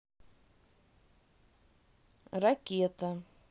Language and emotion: Russian, neutral